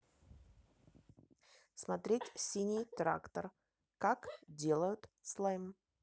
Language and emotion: Russian, neutral